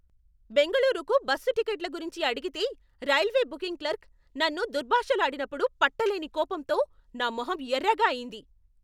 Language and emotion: Telugu, angry